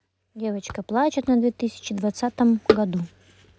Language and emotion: Russian, neutral